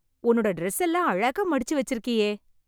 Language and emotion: Tamil, happy